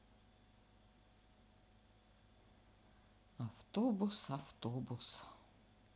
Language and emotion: Russian, sad